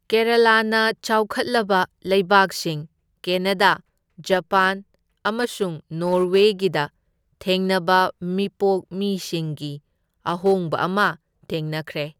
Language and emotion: Manipuri, neutral